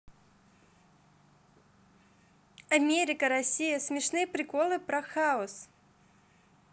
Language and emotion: Russian, positive